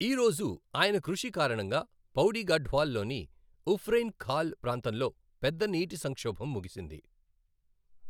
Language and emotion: Telugu, neutral